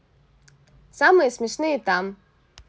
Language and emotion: Russian, positive